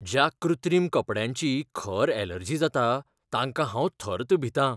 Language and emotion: Goan Konkani, fearful